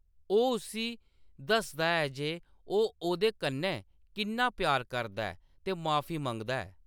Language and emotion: Dogri, neutral